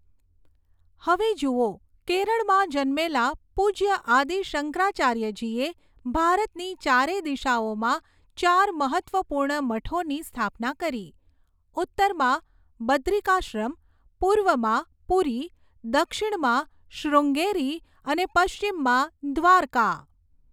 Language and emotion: Gujarati, neutral